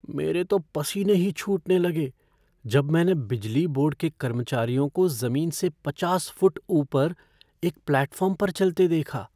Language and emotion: Hindi, fearful